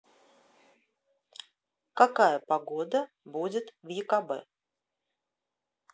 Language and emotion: Russian, neutral